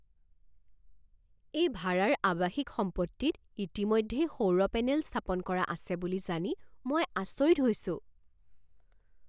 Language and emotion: Assamese, surprised